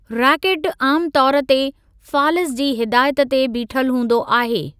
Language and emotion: Sindhi, neutral